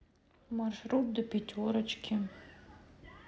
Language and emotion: Russian, sad